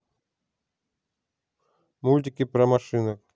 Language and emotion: Russian, neutral